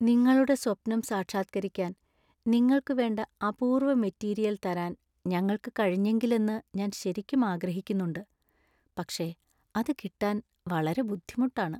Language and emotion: Malayalam, sad